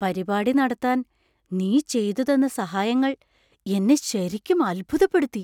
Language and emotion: Malayalam, surprised